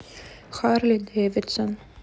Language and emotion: Russian, neutral